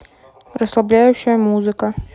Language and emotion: Russian, neutral